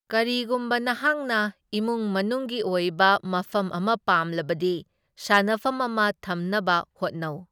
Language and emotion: Manipuri, neutral